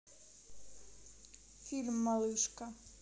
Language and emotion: Russian, neutral